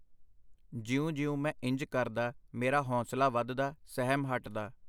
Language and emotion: Punjabi, neutral